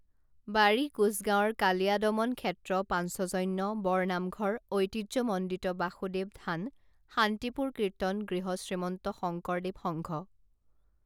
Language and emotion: Assamese, neutral